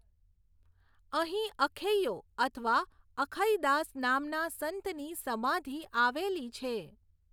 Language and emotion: Gujarati, neutral